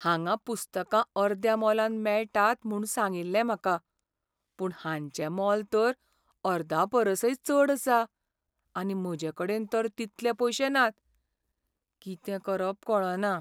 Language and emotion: Goan Konkani, sad